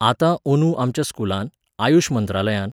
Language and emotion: Goan Konkani, neutral